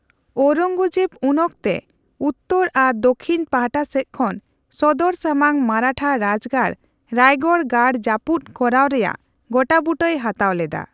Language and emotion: Santali, neutral